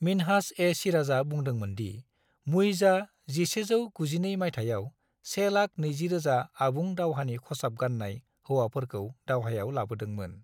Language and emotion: Bodo, neutral